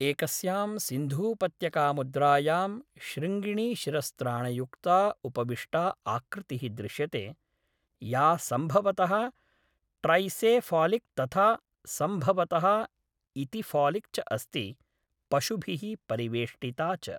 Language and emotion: Sanskrit, neutral